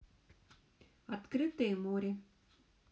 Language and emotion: Russian, neutral